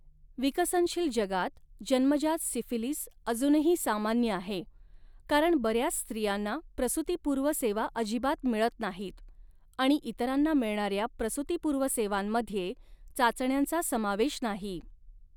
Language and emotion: Marathi, neutral